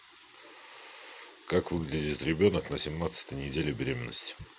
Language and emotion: Russian, neutral